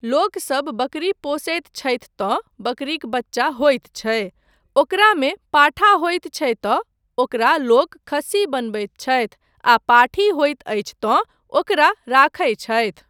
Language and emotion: Maithili, neutral